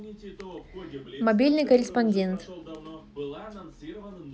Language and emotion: Russian, neutral